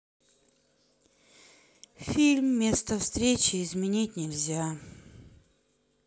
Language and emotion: Russian, sad